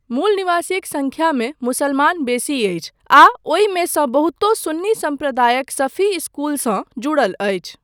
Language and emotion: Maithili, neutral